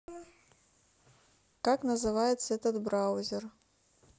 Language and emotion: Russian, neutral